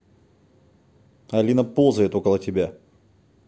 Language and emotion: Russian, neutral